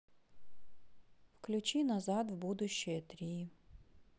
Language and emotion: Russian, sad